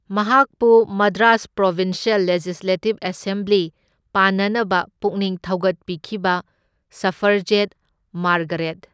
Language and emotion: Manipuri, neutral